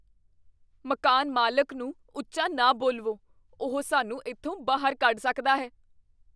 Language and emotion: Punjabi, fearful